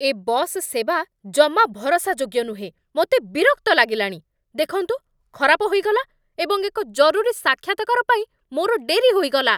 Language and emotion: Odia, angry